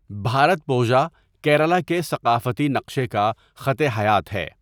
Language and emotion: Urdu, neutral